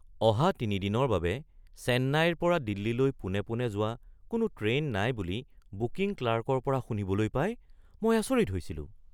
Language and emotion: Assamese, surprised